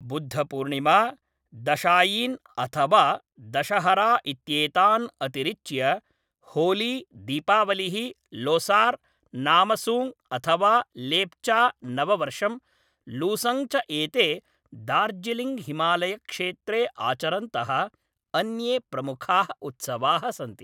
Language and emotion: Sanskrit, neutral